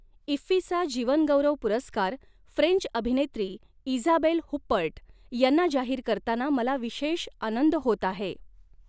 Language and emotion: Marathi, neutral